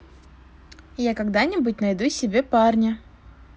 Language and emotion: Russian, positive